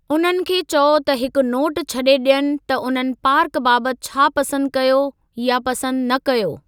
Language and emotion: Sindhi, neutral